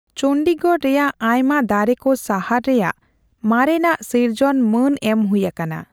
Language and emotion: Santali, neutral